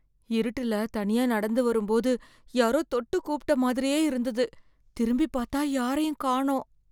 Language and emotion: Tamil, fearful